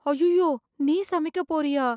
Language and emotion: Tamil, fearful